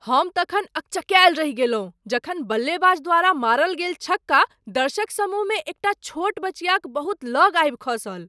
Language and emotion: Maithili, surprised